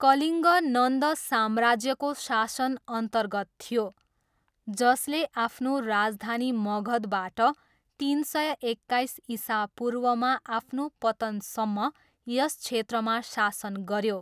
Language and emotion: Nepali, neutral